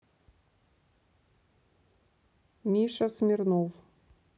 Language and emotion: Russian, neutral